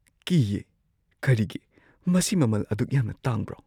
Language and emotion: Manipuri, fearful